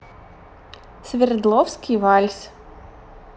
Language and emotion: Russian, positive